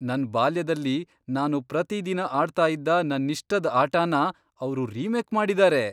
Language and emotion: Kannada, surprised